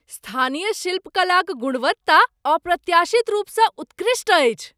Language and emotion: Maithili, surprised